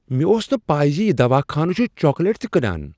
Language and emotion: Kashmiri, surprised